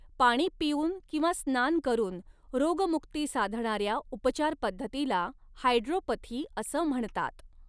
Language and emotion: Marathi, neutral